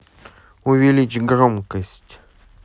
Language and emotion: Russian, neutral